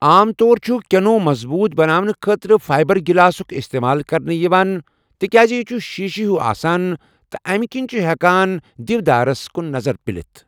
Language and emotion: Kashmiri, neutral